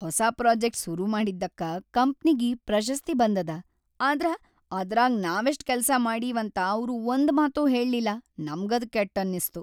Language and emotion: Kannada, sad